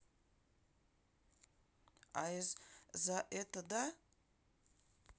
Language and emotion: Russian, neutral